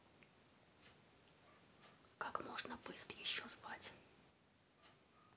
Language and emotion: Russian, neutral